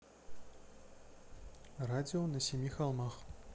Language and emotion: Russian, neutral